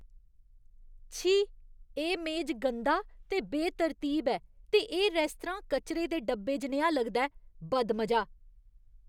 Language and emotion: Dogri, disgusted